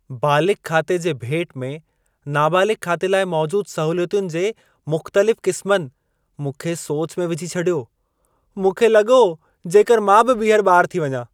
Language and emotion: Sindhi, surprised